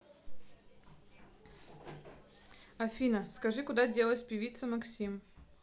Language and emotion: Russian, neutral